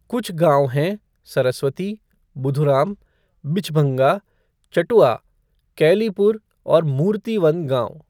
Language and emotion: Hindi, neutral